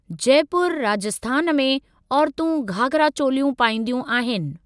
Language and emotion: Sindhi, neutral